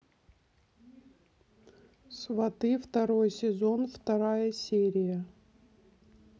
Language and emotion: Russian, neutral